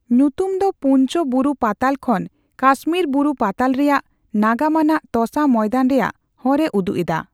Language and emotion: Santali, neutral